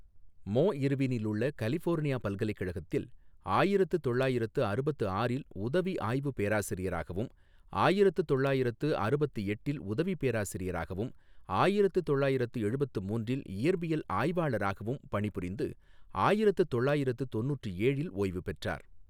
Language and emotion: Tamil, neutral